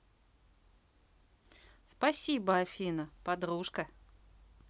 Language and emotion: Russian, positive